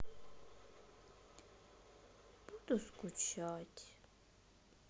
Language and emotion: Russian, sad